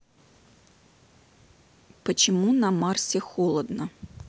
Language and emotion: Russian, neutral